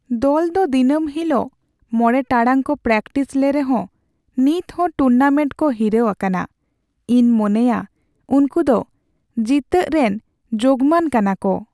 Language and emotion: Santali, sad